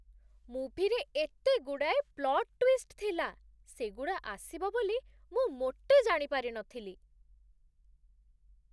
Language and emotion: Odia, surprised